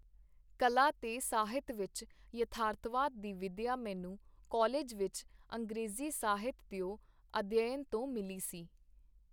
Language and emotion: Punjabi, neutral